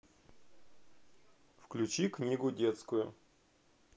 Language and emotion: Russian, neutral